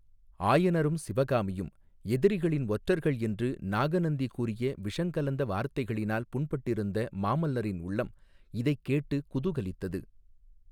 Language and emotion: Tamil, neutral